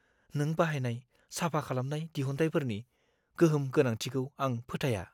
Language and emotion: Bodo, fearful